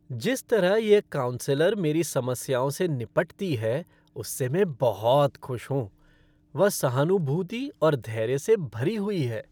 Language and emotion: Hindi, happy